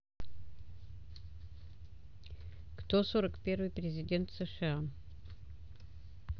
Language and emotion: Russian, neutral